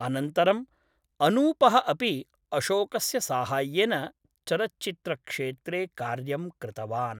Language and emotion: Sanskrit, neutral